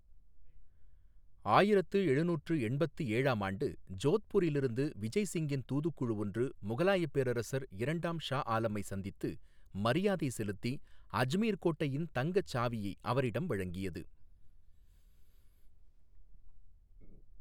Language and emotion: Tamil, neutral